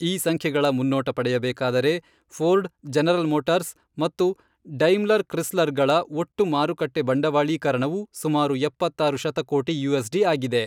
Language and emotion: Kannada, neutral